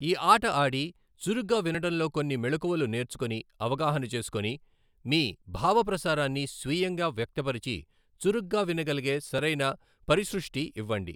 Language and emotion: Telugu, neutral